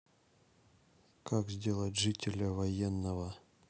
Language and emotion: Russian, neutral